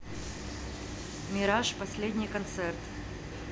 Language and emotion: Russian, neutral